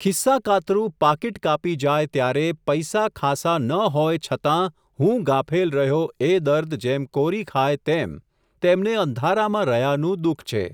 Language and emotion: Gujarati, neutral